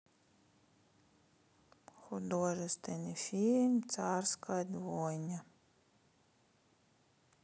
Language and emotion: Russian, sad